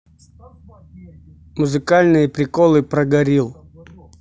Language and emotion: Russian, neutral